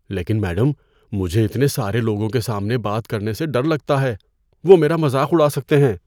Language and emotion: Urdu, fearful